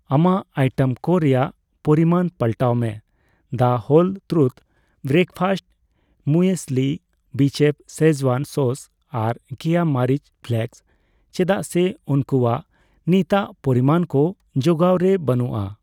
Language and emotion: Santali, neutral